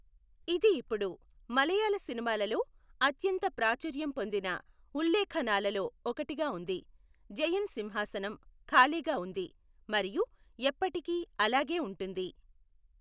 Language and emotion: Telugu, neutral